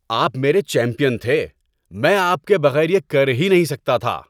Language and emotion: Urdu, happy